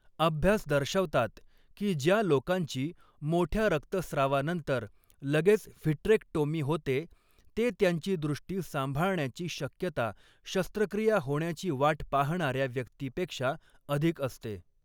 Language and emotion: Marathi, neutral